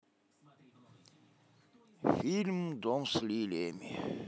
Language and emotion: Russian, positive